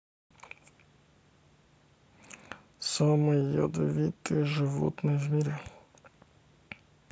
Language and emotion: Russian, neutral